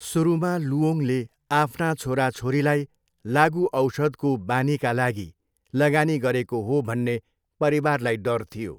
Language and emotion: Nepali, neutral